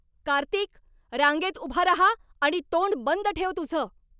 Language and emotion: Marathi, angry